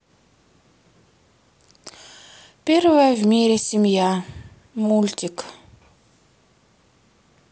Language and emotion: Russian, sad